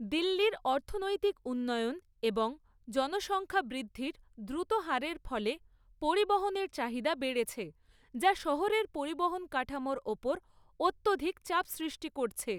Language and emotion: Bengali, neutral